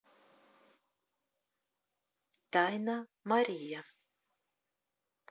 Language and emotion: Russian, neutral